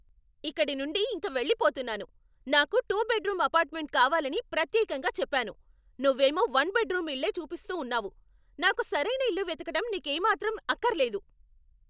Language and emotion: Telugu, angry